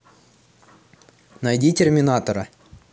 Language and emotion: Russian, neutral